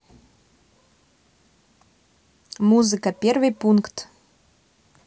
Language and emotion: Russian, neutral